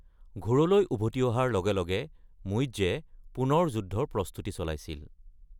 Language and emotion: Assamese, neutral